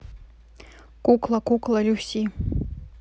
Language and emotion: Russian, neutral